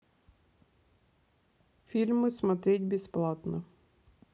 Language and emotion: Russian, neutral